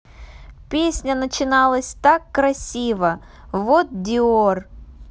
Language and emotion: Russian, neutral